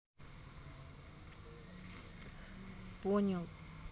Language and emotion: Russian, neutral